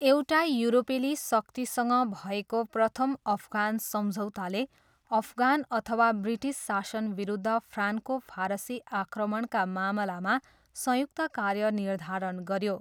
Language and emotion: Nepali, neutral